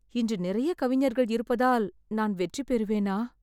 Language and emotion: Tamil, fearful